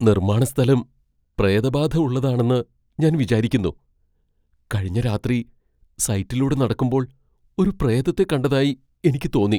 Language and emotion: Malayalam, fearful